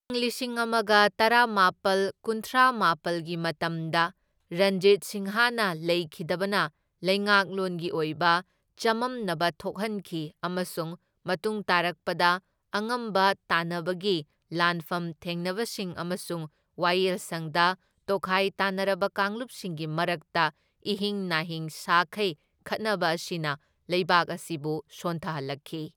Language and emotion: Manipuri, neutral